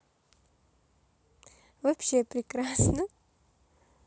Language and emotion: Russian, positive